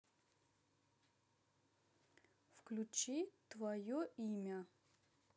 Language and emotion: Russian, neutral